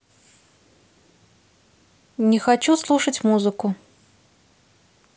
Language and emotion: Russian, neutral